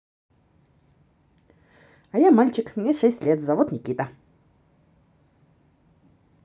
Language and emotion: Russian, positive